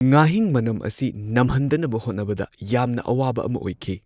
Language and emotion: Manipuri, neutral